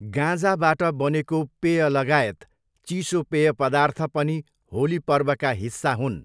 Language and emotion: Nepali, neutral